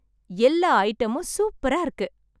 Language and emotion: Tamil, happy